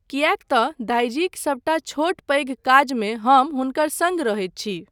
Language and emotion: Maithili, neutral